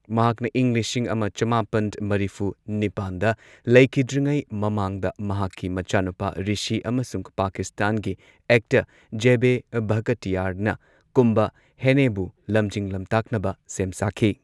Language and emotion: Manipuri, neutral